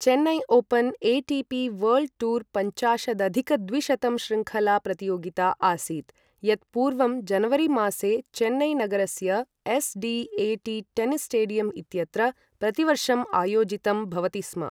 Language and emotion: Sanskrit, neutral